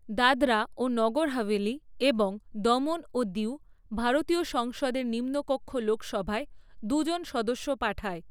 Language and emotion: Bengali, neutral